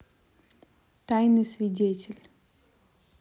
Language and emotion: Russian, neutral